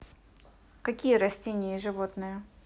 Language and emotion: Russian, neutral